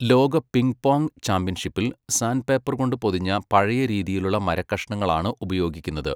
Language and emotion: Malayalam, neutral